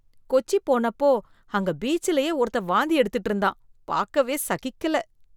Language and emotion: Tamil, disgusted